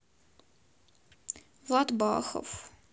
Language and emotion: Russian, sad